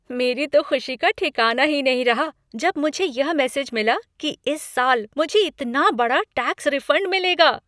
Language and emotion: Hindi, happy